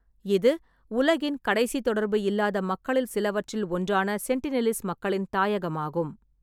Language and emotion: Tamil, neutral